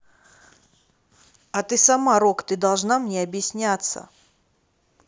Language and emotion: Russian, neutral